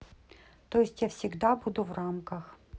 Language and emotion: Russian, neutral